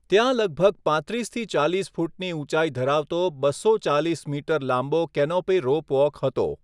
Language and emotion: Gujarati, neutral